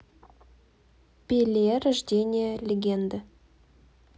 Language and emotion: Russian, neutral